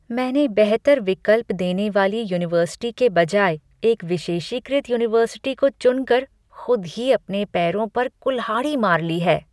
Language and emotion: Hindi, disgusted